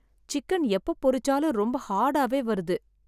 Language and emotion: Tamil, sad